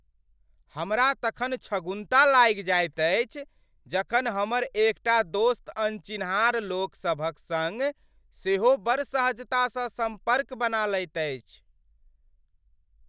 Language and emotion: Maithili, surprised